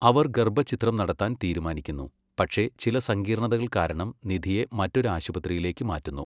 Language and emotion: Malayalam, neutral